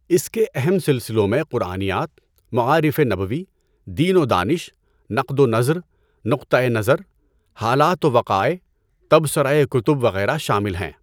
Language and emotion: Urdu, neutral